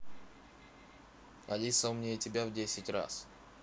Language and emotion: Russian, neutral